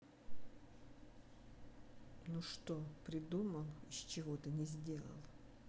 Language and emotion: Russian, angry